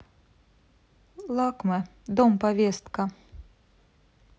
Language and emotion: Russian, neutral